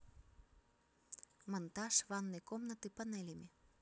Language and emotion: Russian, neutral